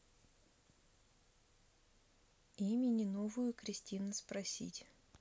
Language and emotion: Russian, neutral